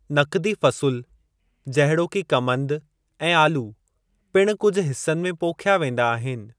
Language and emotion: Sindhi, neutral